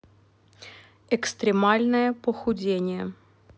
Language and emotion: Russian, neutral